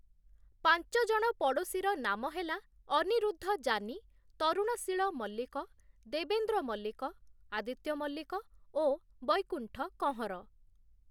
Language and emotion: Odia, neutral